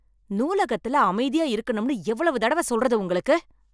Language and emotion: Tamil, angry